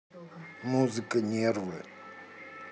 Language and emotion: Russian, neutral